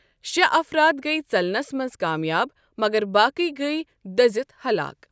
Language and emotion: Kashmiri, neutral